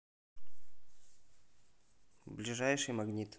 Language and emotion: Russian, neutral